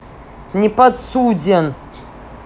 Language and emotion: Russian, angry